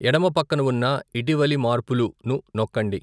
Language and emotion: Telugu, neutral